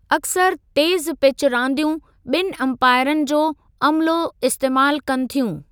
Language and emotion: Sindhi, neutral